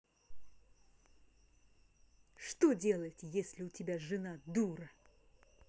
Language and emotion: Russian, angry